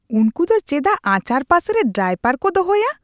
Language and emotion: Santali, disgusted